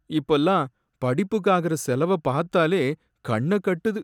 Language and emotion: Tamil, sad